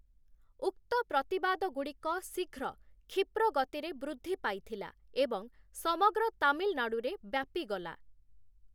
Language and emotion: Odia, neutral